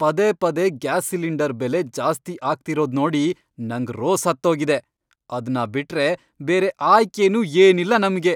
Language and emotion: Kannada, angry